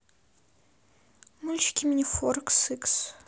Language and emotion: Russian, neutral